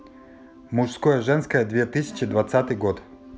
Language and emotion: Russian, neutral